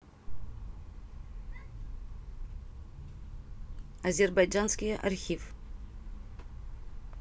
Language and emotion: Russian, neutral